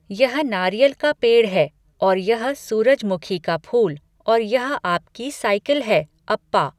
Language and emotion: Hindi, neutral